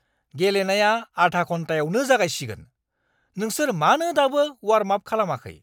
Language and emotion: Bodo, angry